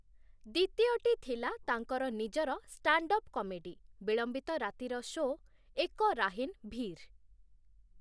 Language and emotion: Odia, neutral